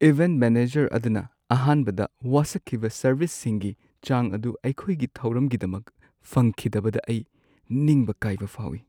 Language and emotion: Manipuri, sad